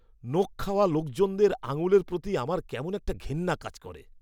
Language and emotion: Bengali, disgusted